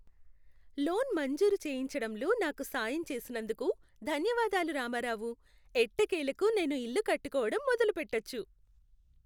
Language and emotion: Telugu, happy